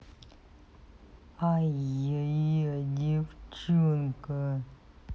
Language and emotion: Russian, angry